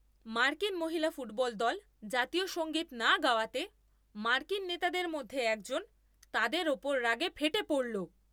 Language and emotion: Bengali, angry